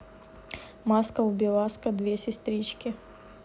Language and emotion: Russian, neutral